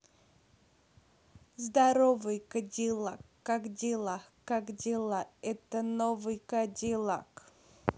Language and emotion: Russian, positive